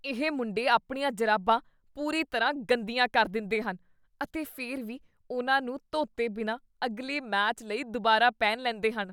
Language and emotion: Punjabi, disgusted